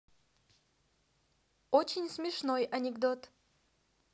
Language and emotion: Russian, neutral